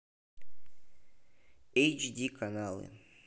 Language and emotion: Russian, neutral